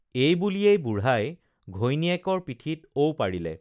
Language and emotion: Assamese, neutral